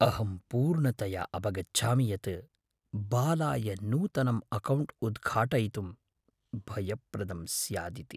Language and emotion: Sanskrit, fearful